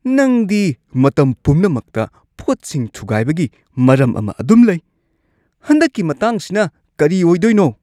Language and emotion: Manipuri, disgusted